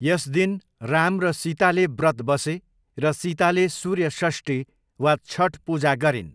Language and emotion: Nepali, neutral